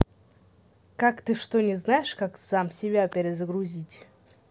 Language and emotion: Russian, neutral